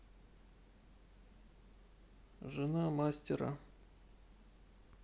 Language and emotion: Russian, neutral